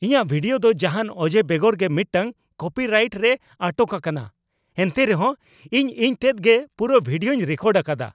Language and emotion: Santali, angry